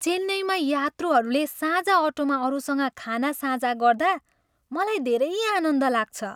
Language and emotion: Nepali, happy